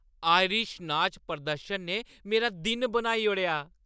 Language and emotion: Dogri, happy